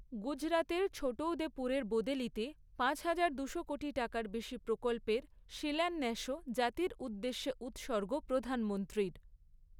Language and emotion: Bengali, neutral